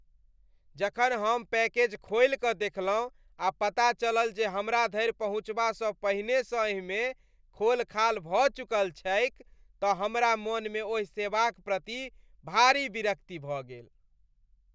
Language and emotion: Maithili, disgusted